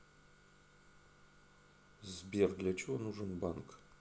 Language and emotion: Russian, neutral